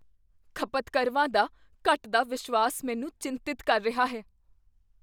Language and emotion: Punjabi, fearful